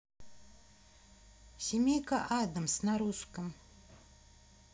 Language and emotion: Russian, neutral